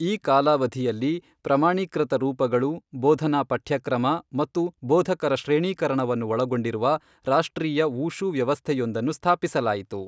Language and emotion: Kannada, neutral